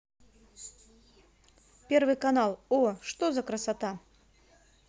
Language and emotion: Russian, positive